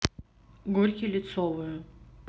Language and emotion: Russian, neutral